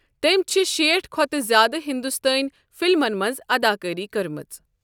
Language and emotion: Kashmiri, neutral